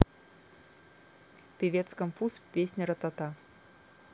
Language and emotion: Russian, neutral